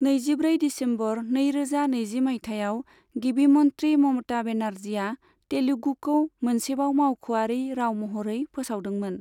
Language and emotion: Bodo, neutral